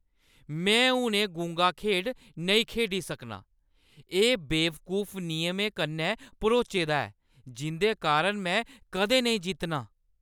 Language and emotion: Dogri, angry